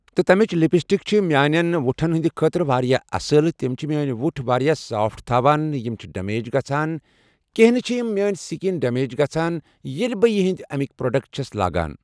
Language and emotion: Kashmiri, neutral